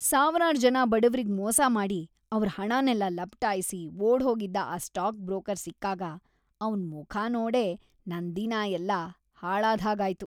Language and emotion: Kannada, disgusted